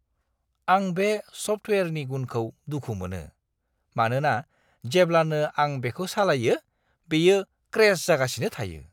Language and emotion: Bodo, disgusted